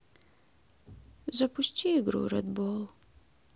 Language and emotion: Russian, sad